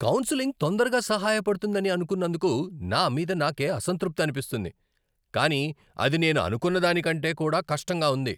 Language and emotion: Telugu, angry